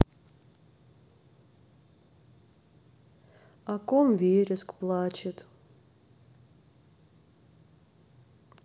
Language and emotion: Russian, sad